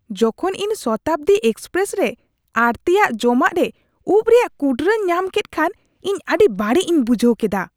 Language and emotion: Santali, disgusted